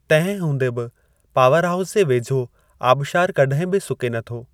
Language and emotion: Sindhi, neutral